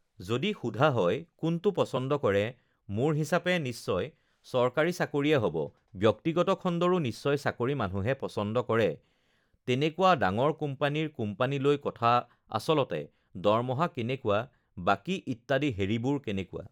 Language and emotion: Assamese, neutral